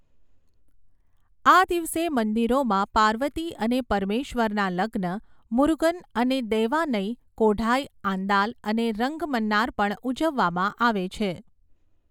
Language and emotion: Gujarati, neutral